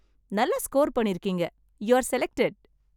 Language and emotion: Tamil, happy